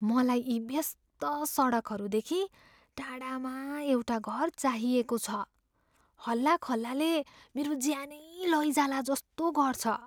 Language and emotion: Nepali, fearful